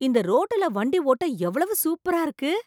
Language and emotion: Tamil, surprised